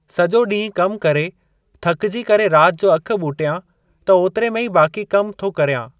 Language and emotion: Sindhi, neutral